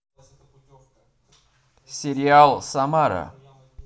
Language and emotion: Russian, positive